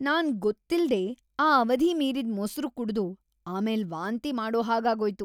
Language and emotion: Kannada, disgusted